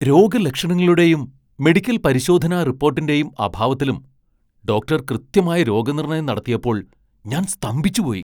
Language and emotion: Malayalam, surprised